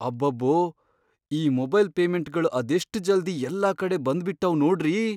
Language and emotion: Kannada, surprised